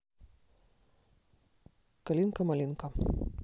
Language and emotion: Russian, neutral